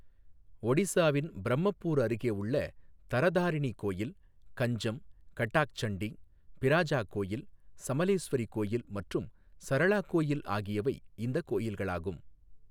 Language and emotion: Tamil, neutral